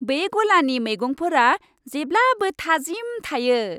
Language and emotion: Bodo, happy